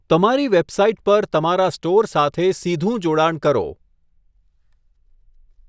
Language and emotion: Gujarati, neutral